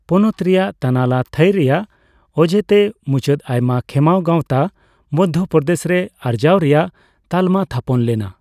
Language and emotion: Santali, neutral